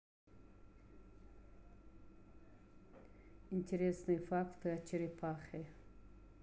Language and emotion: Russian, neutral